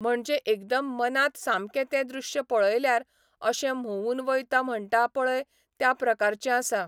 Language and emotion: Goan Konkani, neutral